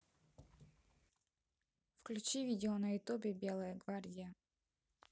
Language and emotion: Russian, neutral